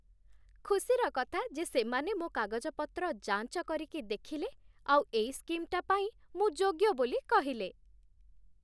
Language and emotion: Odia, happy